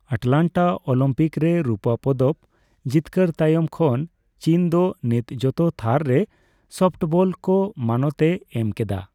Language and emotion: Santali, neutral